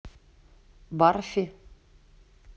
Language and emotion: Russian, neutral